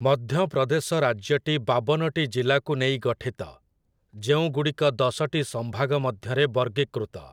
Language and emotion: Odia, neutral